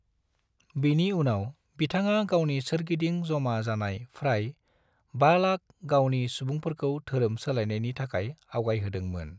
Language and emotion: Bodo, neutral